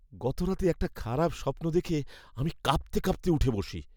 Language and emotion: Bengali, fearful